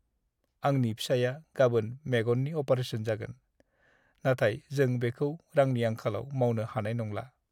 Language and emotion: Bodo, sad